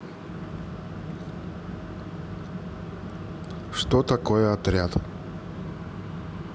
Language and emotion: Russian, neutral